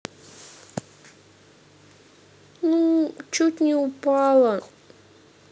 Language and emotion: Russian, sad